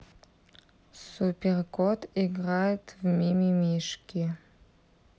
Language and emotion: Russian, neutral